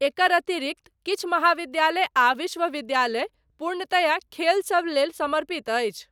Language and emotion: Maithili, neutral